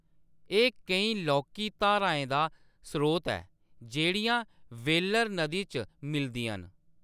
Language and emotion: Dogri, neutral